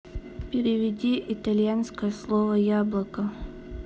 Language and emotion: Russian, neutral